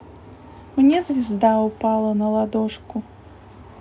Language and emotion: Russian, neutral